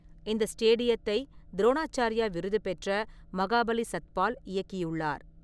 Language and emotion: Tamil, neutral